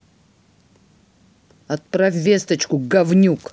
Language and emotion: Russian, angry